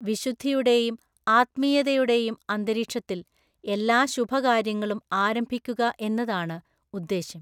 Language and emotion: Malayalam, neutral